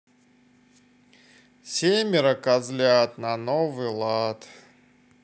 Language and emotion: Russian, neutral